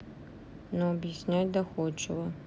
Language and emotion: Russian, neutral